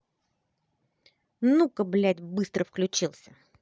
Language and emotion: Russian, angry